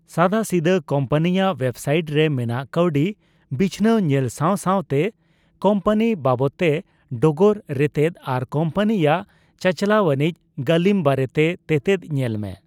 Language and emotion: Santali, neutral